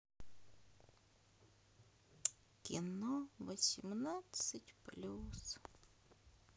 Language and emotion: Russian, sad